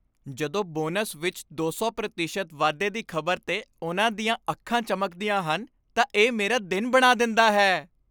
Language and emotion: Punjabi, happy